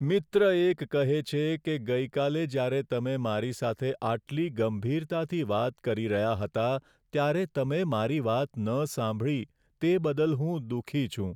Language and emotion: Gujarati, sad